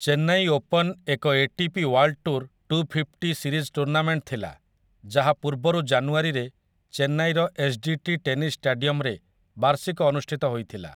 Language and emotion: Odia, neutral